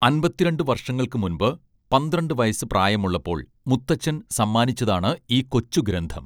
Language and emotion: Malayalam, neutral